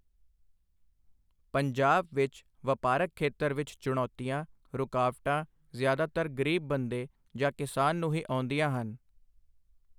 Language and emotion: Punjabi, neutral